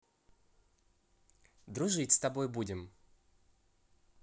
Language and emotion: Russian, positive